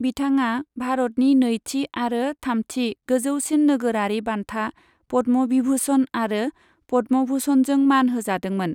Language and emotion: Bodo, neutral